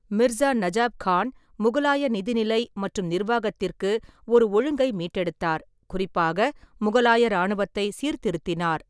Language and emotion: Tamil, neutral